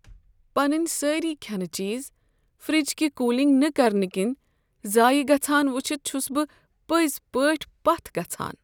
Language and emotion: Kashmiri, sad